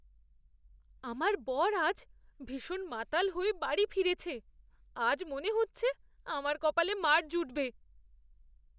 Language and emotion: Bengali, fearful